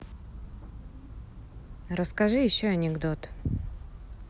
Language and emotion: Russian, neutral